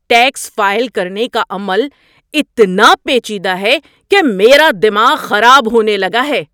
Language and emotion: Urdu, angry